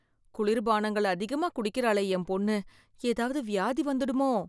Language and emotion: Tamil, fearful